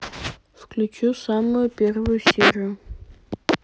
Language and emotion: Russian, neutral